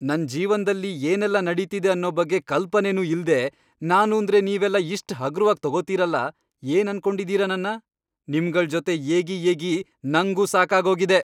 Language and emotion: Kannada, angry